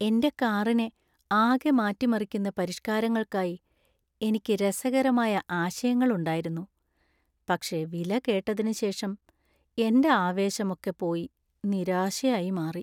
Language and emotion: Malayalam, sad